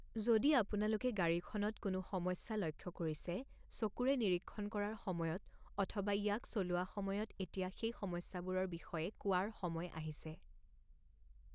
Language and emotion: Assamese, neutral